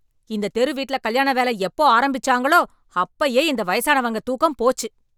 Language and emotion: Tamil, angry